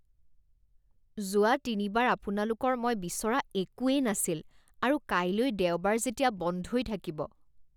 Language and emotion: Assamese, disgusted